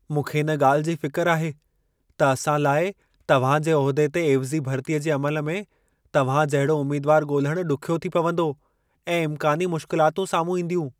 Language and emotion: Sindhi, fearful